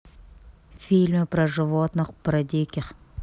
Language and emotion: Russian, neutral